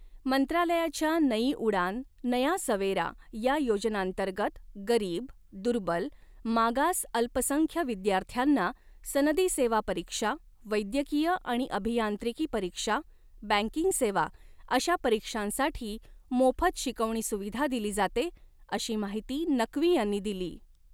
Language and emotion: Marathi, neutral